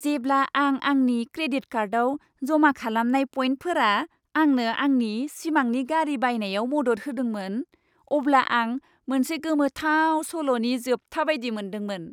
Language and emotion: Bodo, happy